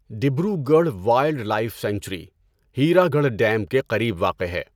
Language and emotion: Urdu, neutral